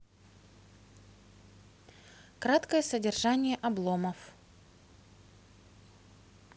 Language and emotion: Russian, neutral